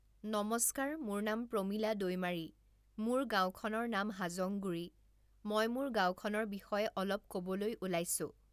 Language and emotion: Assamese, neutral